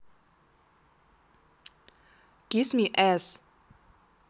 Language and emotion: Russian, neutral